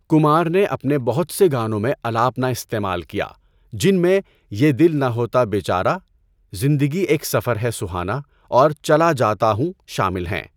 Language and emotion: Urdu, neutral